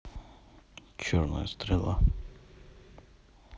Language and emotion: Russian, neutral